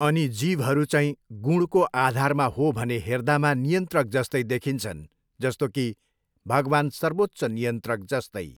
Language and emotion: Nepali, neutral